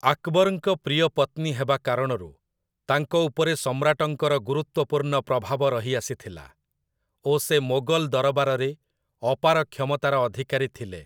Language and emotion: Odia, neutral